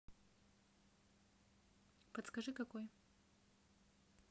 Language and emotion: Russian, neutral